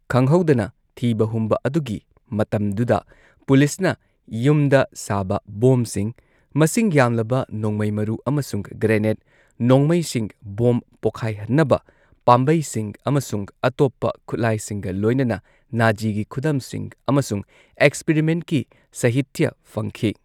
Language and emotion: Manipuri, neutral